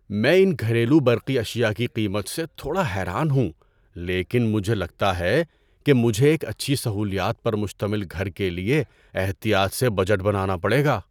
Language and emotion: Urdu, surprised